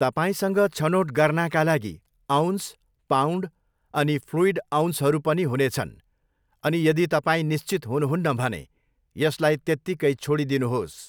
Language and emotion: Nepali, neutral